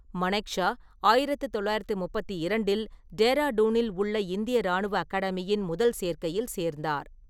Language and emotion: Tamil, neutral